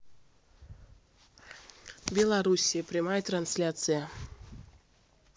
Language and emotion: Russian, neutral